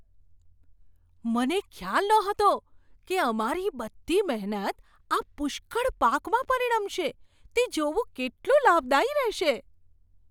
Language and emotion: Gujarati, surprised